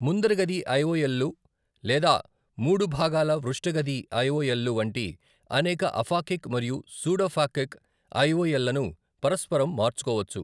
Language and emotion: Telugu, neutral